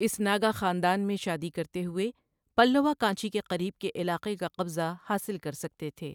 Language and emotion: Urdu, neutral